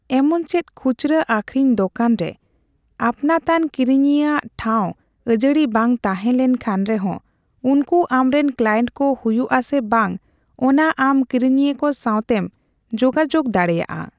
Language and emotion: Santali, neutral